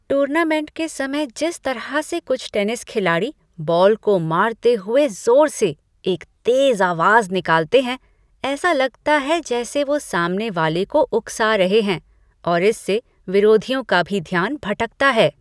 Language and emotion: Hindi, disgusted